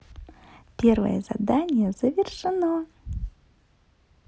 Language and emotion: Russian, positive